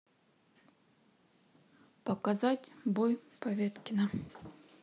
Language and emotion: Russian, neutral